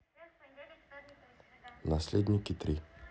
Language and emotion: Russian, neutral